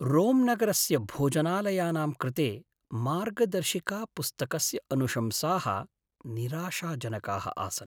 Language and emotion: Sanskrit, sad